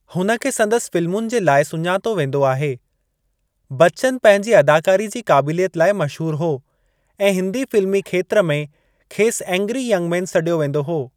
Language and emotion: Sindhi, neutral